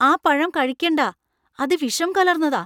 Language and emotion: Malayalam, fearful